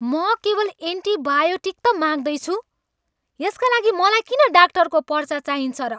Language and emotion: Nepali, angry